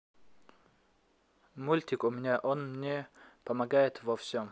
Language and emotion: Russian, neutral